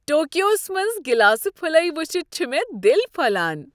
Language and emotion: Kashmiri, happy